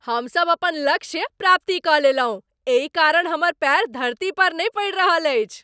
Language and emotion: Maithili, happy